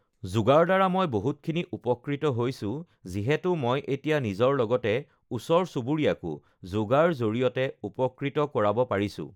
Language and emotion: Assamese, neutral